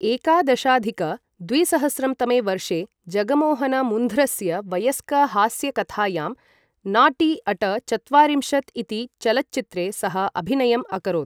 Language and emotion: Sanskrit, neutral